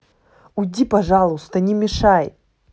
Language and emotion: Russian, angry